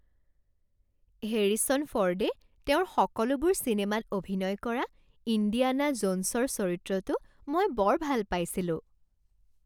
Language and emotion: Assamese, happy